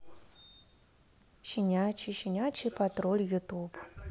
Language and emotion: Russian, neutral